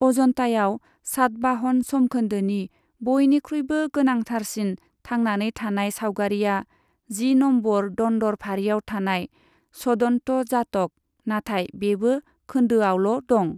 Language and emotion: Bodo, neutral